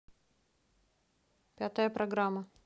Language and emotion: Russian, neutral